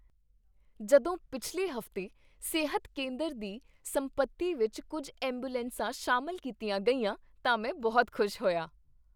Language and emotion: Punjabi, happy